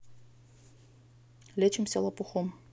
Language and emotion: Russian, neutral